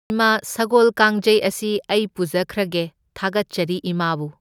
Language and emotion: Manipuri, neutral